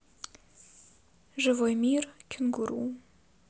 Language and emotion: Russian, sad